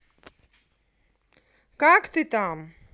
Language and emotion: Russian, positive